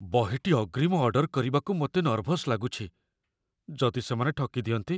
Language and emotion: Odia, fearful